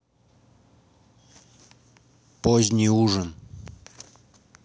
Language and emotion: Russian, neutral